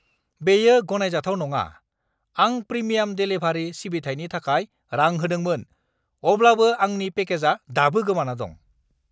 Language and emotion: Bodo, angry